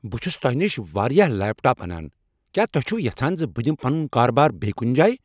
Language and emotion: Kashmiri, angry